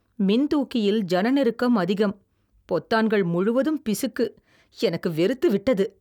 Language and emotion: Tamil, disgusted